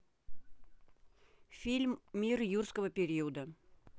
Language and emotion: Russian, neutral